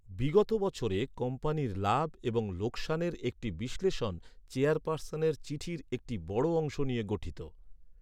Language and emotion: Bengali, neutral